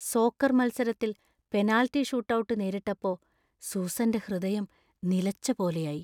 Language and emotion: Malayalam, fearful